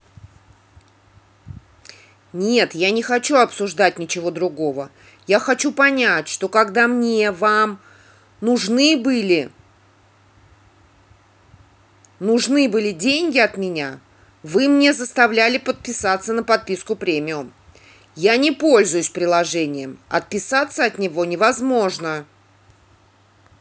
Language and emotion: Russian, angry